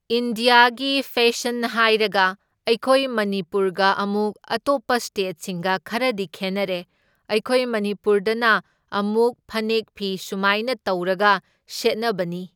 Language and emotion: Manipuri, neutral